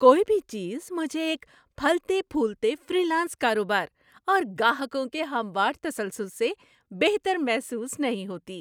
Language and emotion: Urdu, happy